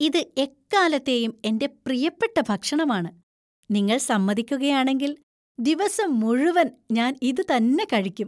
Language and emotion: Malayalam, happy